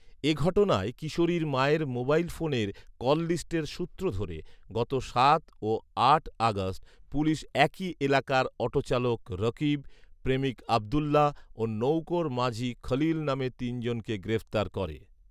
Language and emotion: Bengali, neutral